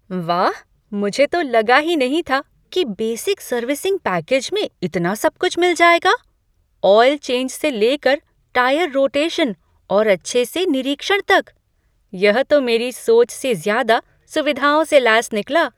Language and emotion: Hindi, surprised